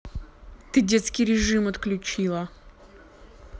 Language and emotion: Russian, angry